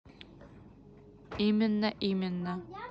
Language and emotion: Russian, neutral